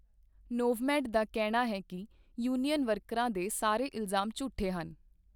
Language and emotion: Punjabi, neutral